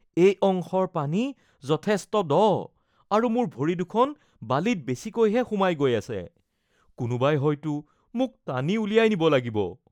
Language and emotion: Assamese, fearful